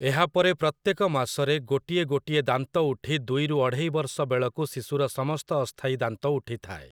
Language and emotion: Odia, neutral